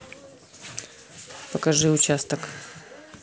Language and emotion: Russian, neutral